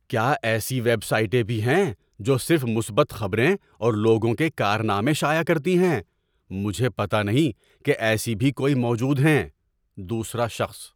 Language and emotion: Urdu, surprised